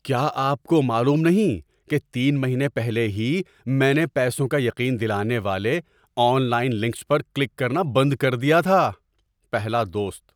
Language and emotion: Urdu, surprised